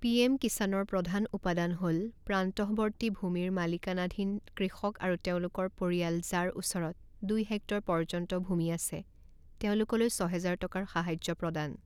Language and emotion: Assamese, neutral